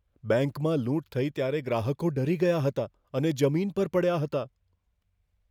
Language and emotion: Gujarati, fearful